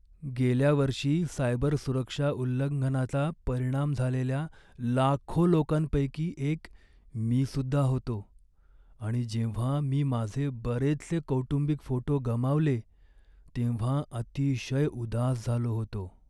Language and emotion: Marathi, sad